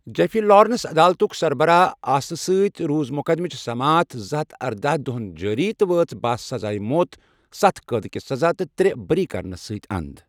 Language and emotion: Kashmiri, neutral